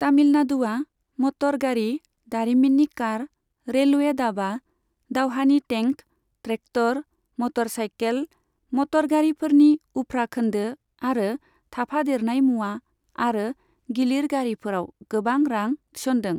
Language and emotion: Bodo, neutral